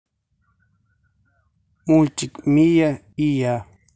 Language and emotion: Russian, neutral